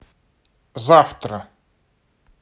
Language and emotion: Russian, neutral